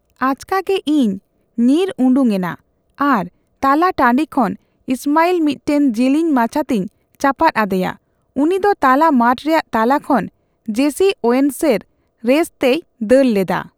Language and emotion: Santali, neutral